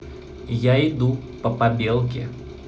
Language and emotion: Russian, positive